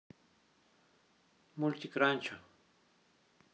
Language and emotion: Russian, neutral